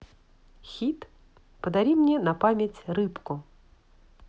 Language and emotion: Russian, positive